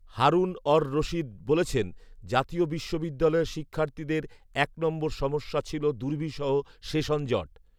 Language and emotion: Bengali, neutral